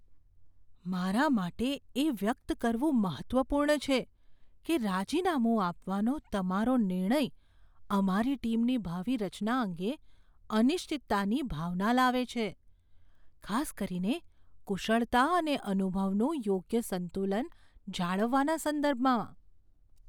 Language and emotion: Gujarati, fearful